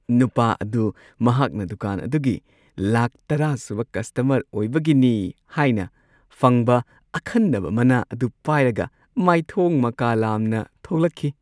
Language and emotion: Manipuri, happy